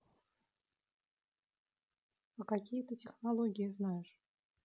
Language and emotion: Russian, neutral